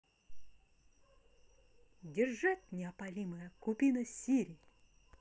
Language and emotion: Russian, positive